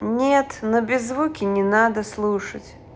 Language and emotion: Russian, neutral